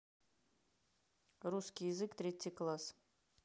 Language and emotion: Russian, neutral